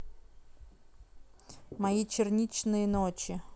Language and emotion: Russian, neutral